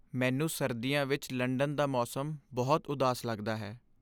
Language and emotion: Punjabi, sad